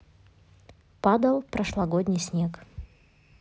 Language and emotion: Russian, neutral